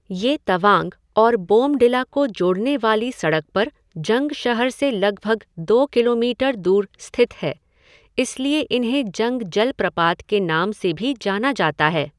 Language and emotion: Hindi, neutral